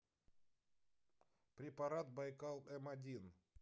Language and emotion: Russian, neutral